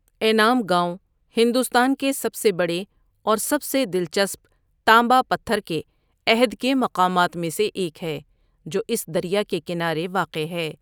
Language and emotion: Urdu, neutral